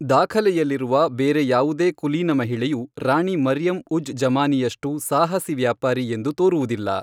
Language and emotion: Kannada, neutral